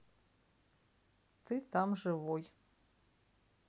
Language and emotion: Russian, neutral